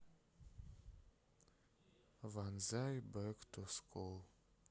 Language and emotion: Russian, sad